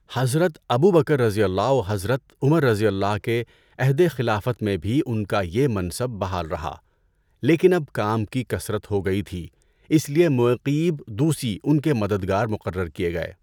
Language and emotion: Urdu, neutral